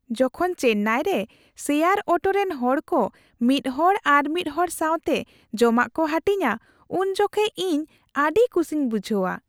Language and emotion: Santali, happy